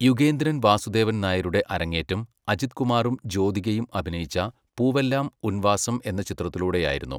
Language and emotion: Malayalam, neutral